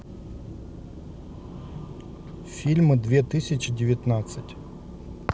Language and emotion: Russian, neutral